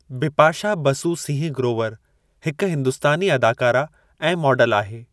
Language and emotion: Sindhi, neutral